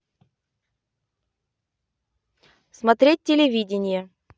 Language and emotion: Russian, neutral